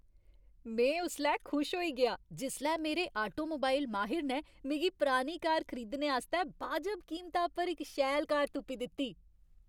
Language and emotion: Dogri, happy